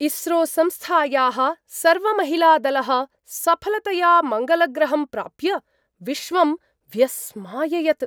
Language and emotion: Sanskrit, surprised